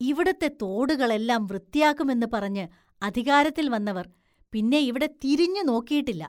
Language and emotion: Malayalam, disgusted